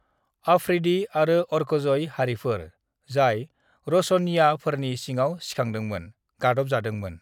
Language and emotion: Bodo, neutral